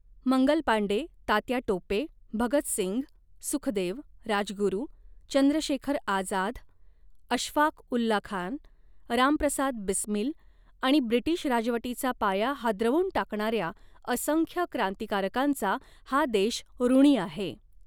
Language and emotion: Marathi, neutral